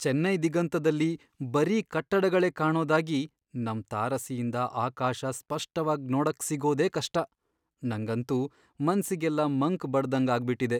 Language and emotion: Kannada, sad